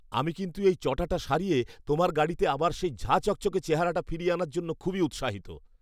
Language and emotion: Bengali, happy